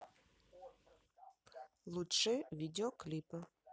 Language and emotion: Russian, neutral